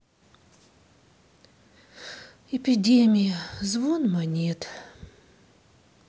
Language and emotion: Russian, sad